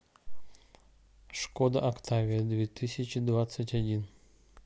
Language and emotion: Russian, neutral